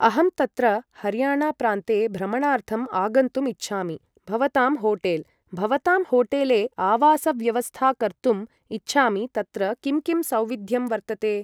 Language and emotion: Sanskrit, neutral